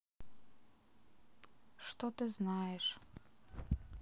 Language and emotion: Russian, sad